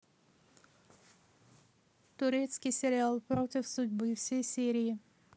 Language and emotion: Russian, neutral